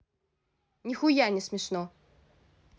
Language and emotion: Russian, angry